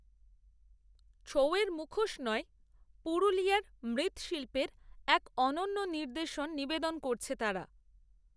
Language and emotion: Bengali, neutral